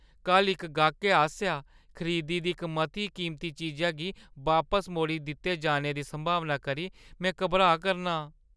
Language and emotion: Dogri, fearful